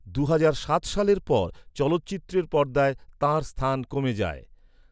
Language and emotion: Bengali, neutral